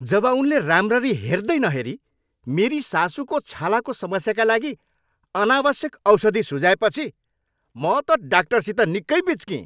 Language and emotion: Nepali, angry